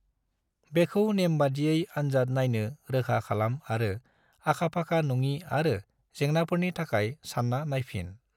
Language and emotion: Bodo, neutral